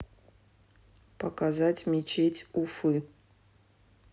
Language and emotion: Russian, neutral